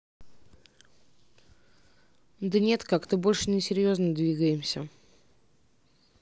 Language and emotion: Russian, neutral